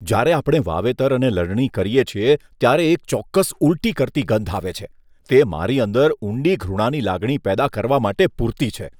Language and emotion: Gujarati, disgusted